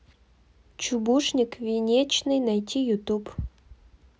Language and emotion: Russian, neutral